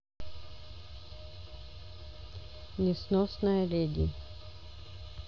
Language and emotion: Russian, neutral